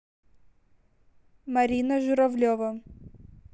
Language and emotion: Russian, neutral